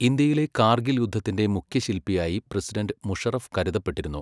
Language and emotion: Malayalam, neutral